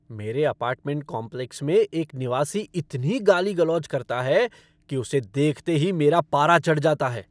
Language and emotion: Hindi, angry